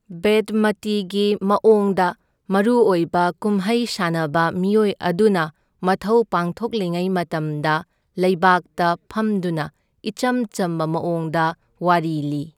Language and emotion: Manipuri, neutral